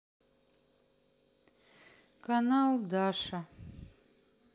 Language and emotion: Russian, sad